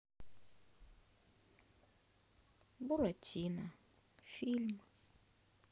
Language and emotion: Russian, sad